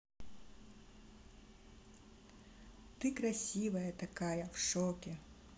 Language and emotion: Russian, positive